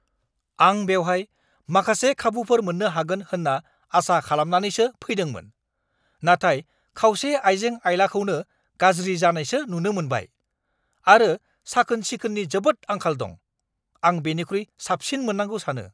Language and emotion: Bodo, angry